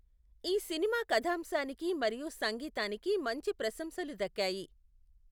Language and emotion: Telugu, neutral